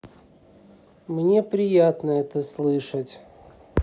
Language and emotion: Russian, neutral